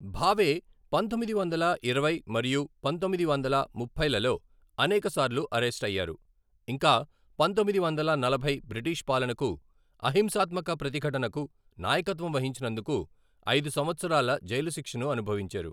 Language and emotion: Telugu, neutral